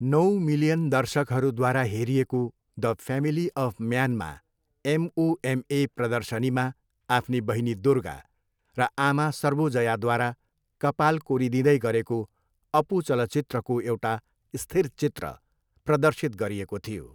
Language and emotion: Nepali, neutral